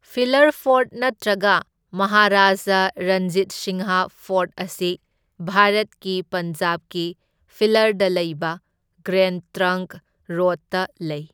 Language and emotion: Manipuri, neutral